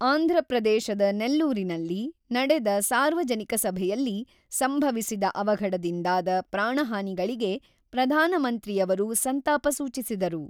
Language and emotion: Kannada, neutral